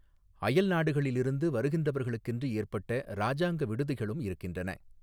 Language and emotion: Tamil, neutral